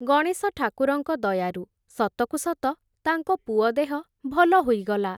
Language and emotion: Odia, neutral